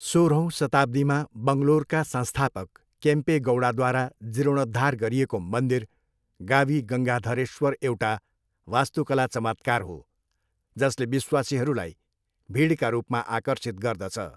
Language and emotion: Nepali, neutral